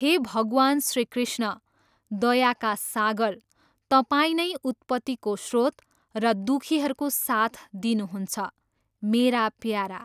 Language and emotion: Nepali, neutral